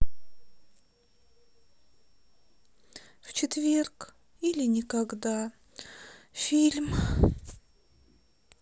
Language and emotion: Russian, sad